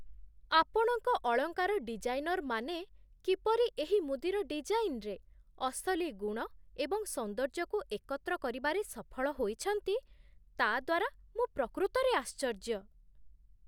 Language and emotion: Odia, surprised